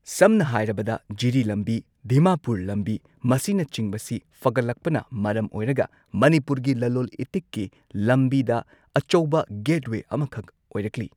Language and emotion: Manipuri, neutral